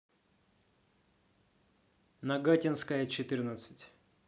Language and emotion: Russian, neutral